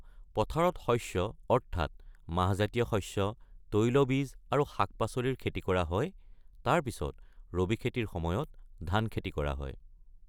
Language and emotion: Assamese, neutral